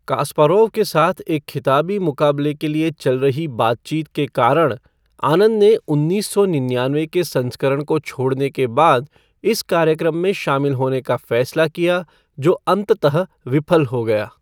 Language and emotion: Hindi, neutral